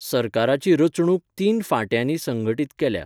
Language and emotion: Goan Konkani, neutral